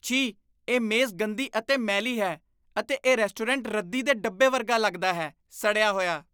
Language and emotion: Punjabi, disgusted